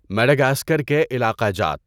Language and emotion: Urdu, neutral